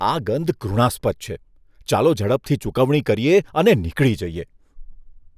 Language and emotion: Gujarati, disgusted